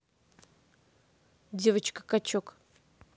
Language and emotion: Russian, neutral